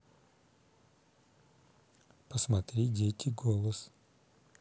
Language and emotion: Russian, neutral